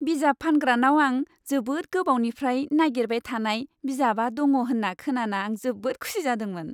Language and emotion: Bodo, happy